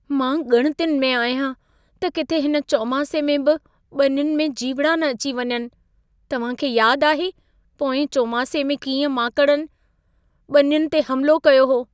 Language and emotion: Sindhi, fearful